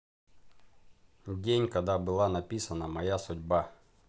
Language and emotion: Russian, neutral